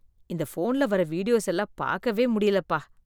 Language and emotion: Tamil, disgusted